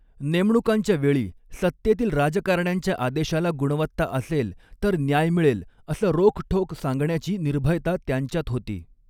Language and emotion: Marathi, neutral